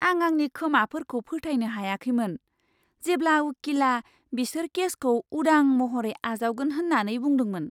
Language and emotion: Bodo, surprised